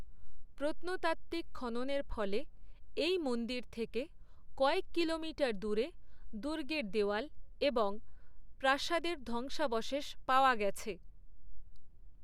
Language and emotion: Bengali, neutral